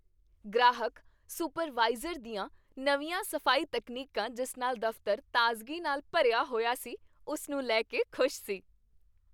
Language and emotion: Punjabi, happy